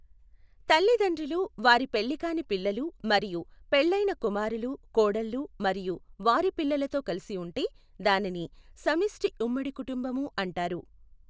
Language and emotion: Telugu, neutral